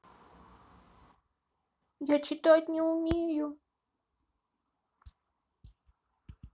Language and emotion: Russian, sad